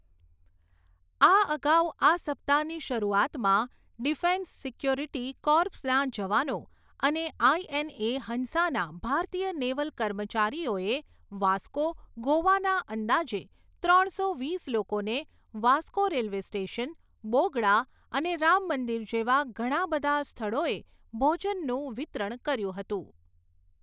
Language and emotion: Gujarati, neutral